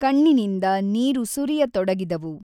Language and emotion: Kannada, neutral